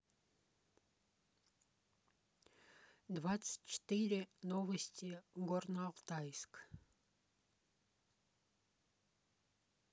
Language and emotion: Russian, neutral